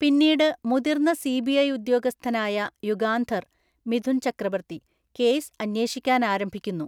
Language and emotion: Malayalam, neutral